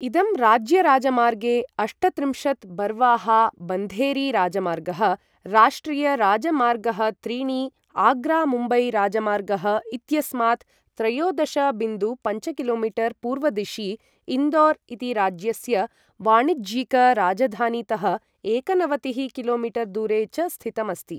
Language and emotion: Sanskrit, neutral